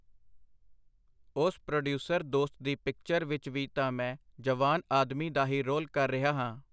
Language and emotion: Punjabi, neutral